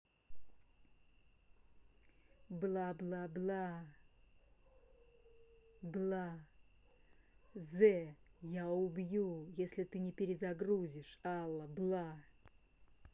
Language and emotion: Russian, angry